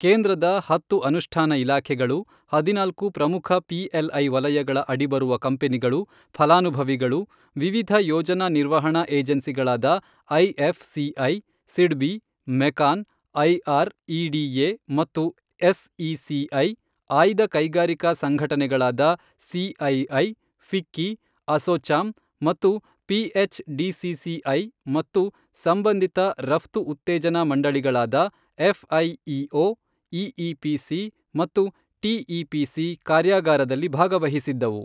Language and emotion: Kannada, neutral